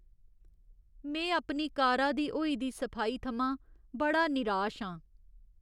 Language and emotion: Dogri, sad